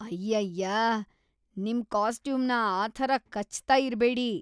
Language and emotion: Kannada, disgusted